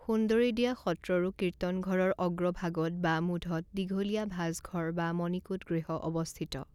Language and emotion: Assamese, neutral